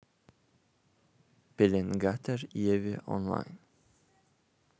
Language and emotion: Russian, neutral